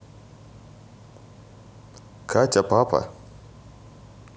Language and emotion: Russian, neutral